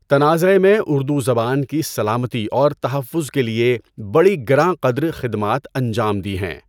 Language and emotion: Urdu, neutral